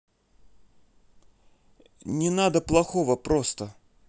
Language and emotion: Russian, neutral